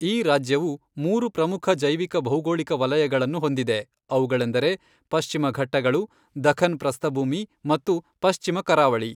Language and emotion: Kannada, neutral